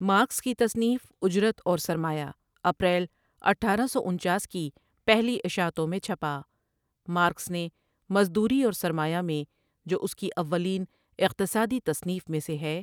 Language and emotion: Urdu, neutral